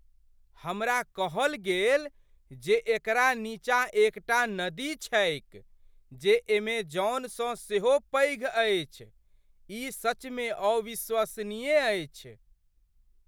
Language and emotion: Maithili, surprised